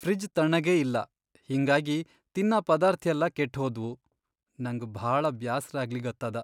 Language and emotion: Kannada, sad